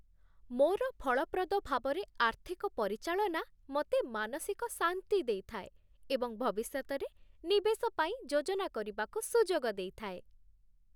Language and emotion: Odia, happy